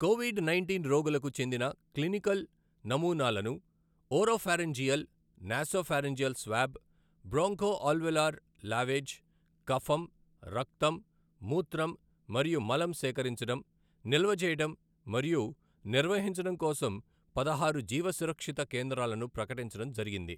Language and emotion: Telugu, neutral